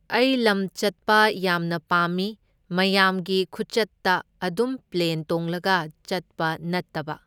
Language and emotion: Manipuri, neutral